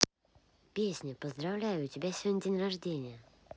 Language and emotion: Russian, positive